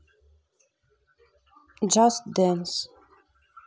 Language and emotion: Russian, neutral